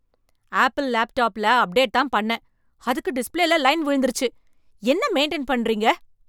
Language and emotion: Tamil, angry